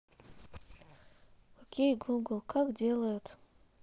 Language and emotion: Russian, sad